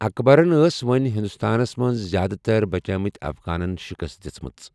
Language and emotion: Kashmiri, neutral